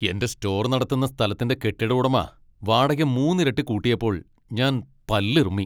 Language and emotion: Malayalam, angry